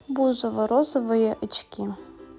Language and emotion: Russian, neutral